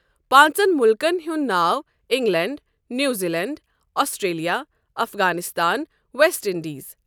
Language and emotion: Kashmiri, neutral